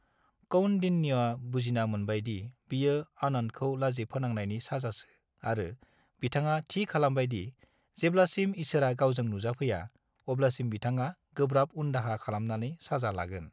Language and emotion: Bodo, neutral